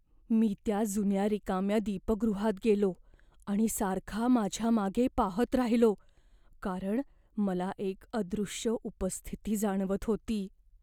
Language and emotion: Marathi, fearful